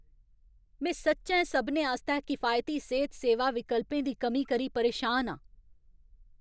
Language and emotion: Dogri, angry